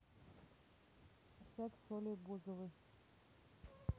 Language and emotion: Russian, neutral